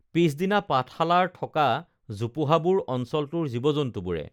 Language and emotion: Assamese, neutral